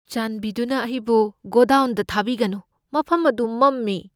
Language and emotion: Manipuri, fearful